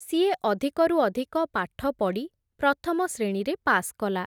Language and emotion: Odia, neutral